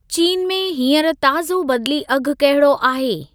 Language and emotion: Sindhi, neutral